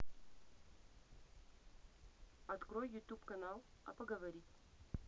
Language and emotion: Russian, neutral